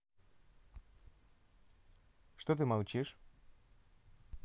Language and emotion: Russian, neutral